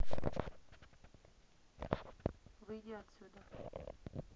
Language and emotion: Russian, neutral